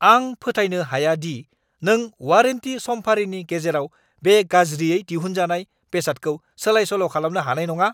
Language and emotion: Bodo, angry